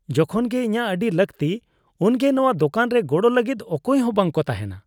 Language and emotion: Santali, disgusted